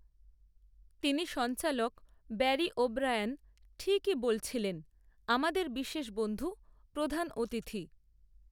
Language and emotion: Bengali, neutral